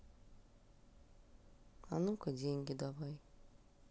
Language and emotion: Russian, neutral